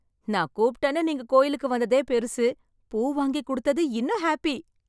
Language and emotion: Tamil, happy